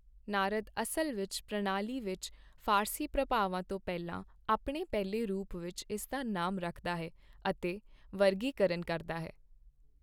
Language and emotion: Punjabi, neutral